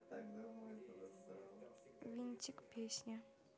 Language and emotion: Russian, neutral